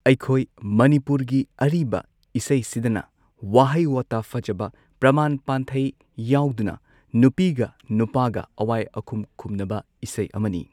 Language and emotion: Manipuri, neutral